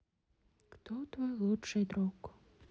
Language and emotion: Russian, sad